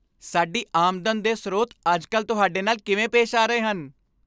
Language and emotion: Punjabi, happy